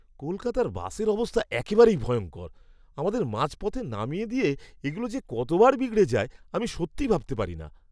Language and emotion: Bengali, disgusted